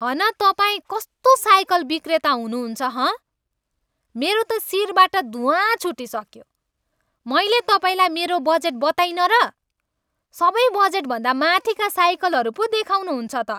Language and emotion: Nepali, angry